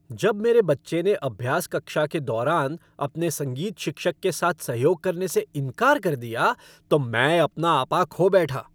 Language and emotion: Hindi, angry